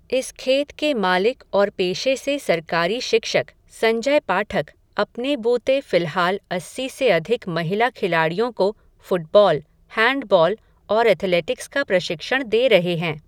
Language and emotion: Hindi, neutral